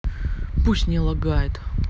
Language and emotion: Russian, angry